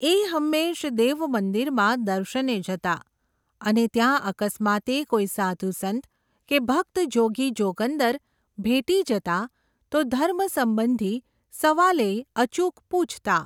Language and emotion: Gujarati, neutral